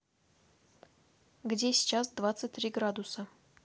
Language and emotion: Russian, neutral